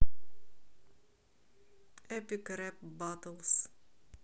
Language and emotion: Russian, neutral